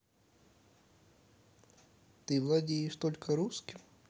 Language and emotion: Russian, neutral